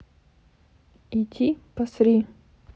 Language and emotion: Russian, neutral